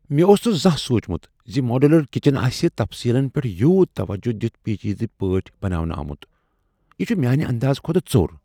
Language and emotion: Kashmiri, surprised